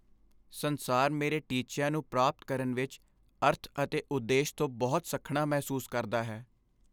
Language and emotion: Punjabi, sad